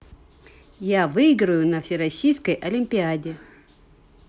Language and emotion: Russian, positive